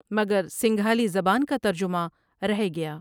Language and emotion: Urdu, neutral